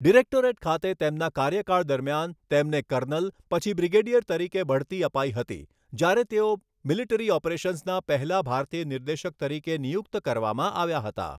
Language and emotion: Gujarati, neutral